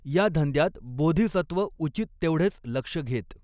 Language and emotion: Marathi, neutral